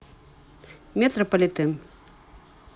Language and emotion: Russian, neutral